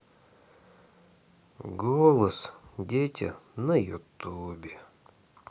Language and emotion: Russian, sad